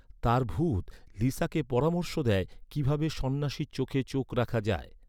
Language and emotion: Bengali, neutral